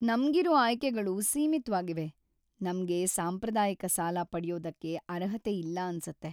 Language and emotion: Kannada, sad